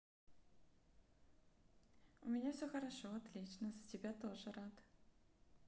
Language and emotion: Russian, positive